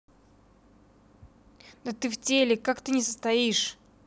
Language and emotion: Russian, angry